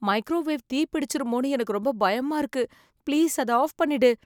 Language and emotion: Tamil, fearful